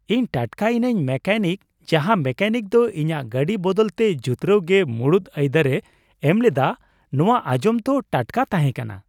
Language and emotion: Santali, surprised